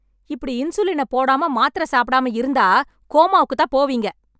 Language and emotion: Tamil, angry